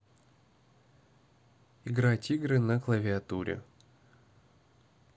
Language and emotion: Russian, neutral